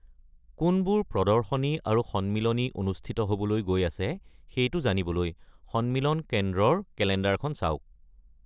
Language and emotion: Assamese, neutral